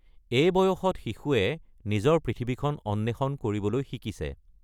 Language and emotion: Assamese, neutral